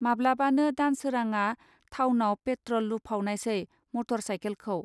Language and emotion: Bodo, neutral